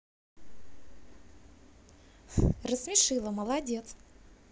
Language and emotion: Russian, positive